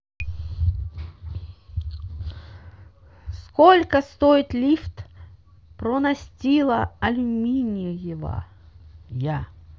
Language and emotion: Russian, neutral